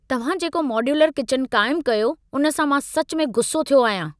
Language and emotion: Sindhi, angry